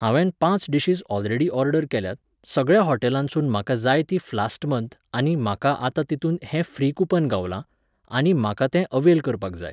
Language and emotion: Goan Konkani, neutral